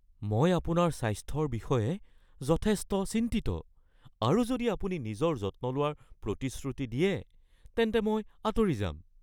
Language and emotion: Assamese, fearful